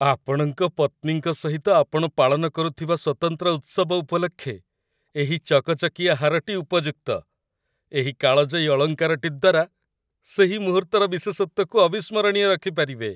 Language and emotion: Odia, happy